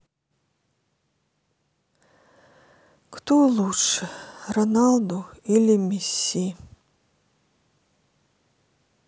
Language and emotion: Russian, sad